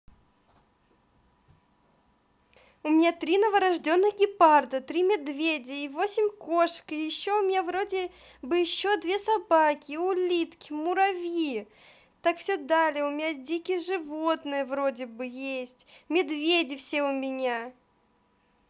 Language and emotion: Russian, positive